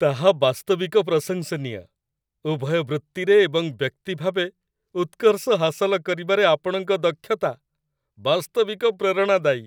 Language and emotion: Odia, happy